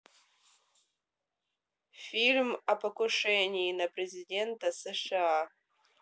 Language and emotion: Russian, neutral